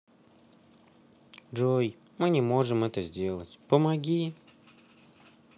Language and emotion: Russian, sad